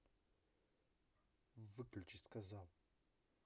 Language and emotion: Russian, angry